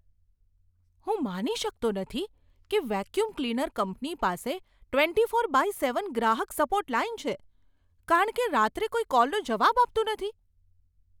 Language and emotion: Gujarati, surprised